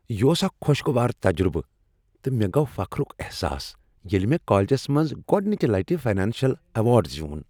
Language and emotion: Kashmiri, happy